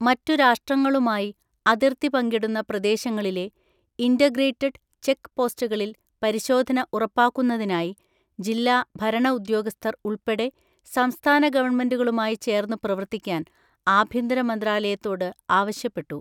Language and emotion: Malayalam, neutral